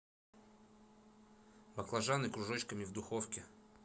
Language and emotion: Russian, neutral